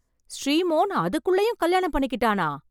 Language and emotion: Tamil, surprised